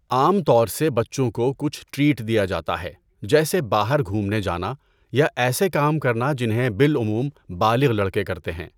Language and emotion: Urdu, neutral